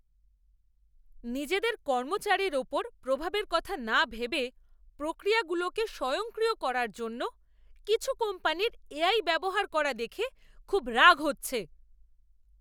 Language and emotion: Bengali, angry